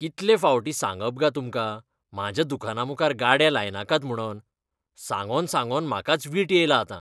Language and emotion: Goan Konkani, disgusted